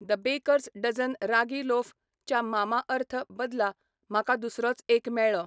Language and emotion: Goan Konkani, neutral